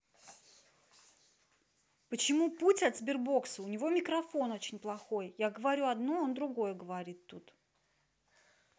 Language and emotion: Russian, angry